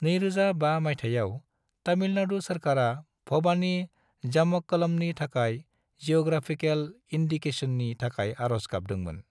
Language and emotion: Bodo, neutral